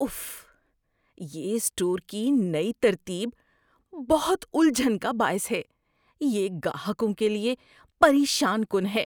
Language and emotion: Urdu, disgusted